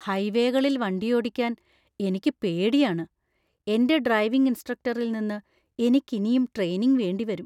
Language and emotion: Malayalam, fearful